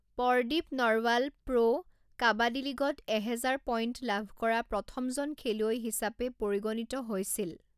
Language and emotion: Assamese, neutral